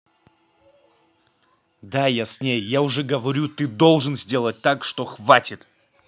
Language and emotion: Russian, angry